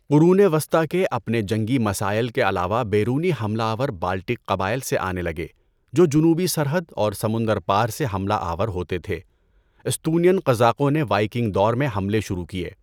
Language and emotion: Urdu, neutral